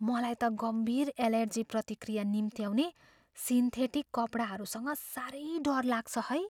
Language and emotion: Nepali, fearful